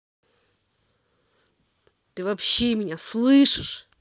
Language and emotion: Russian, angry